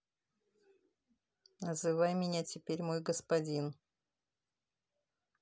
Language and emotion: Russian, neutral